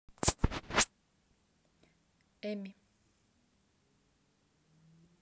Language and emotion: Russian, neutral